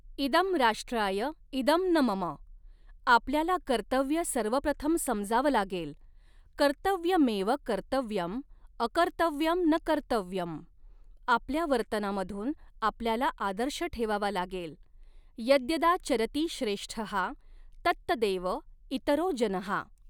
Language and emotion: Marathi, neutral